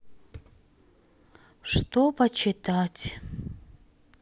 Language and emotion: Russian, sad